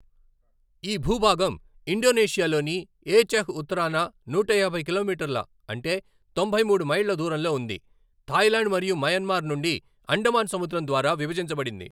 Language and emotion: Telugu, neutral